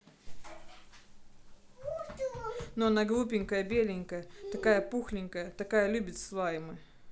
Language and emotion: Russian, neutral